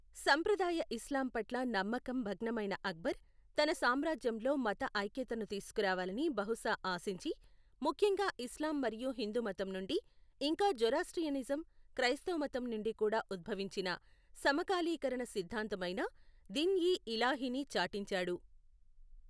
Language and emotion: Telugu, neutral